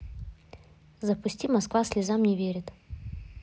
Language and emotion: Russian, neutral